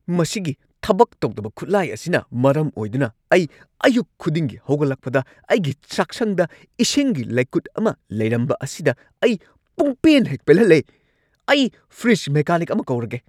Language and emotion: Manipuri, angry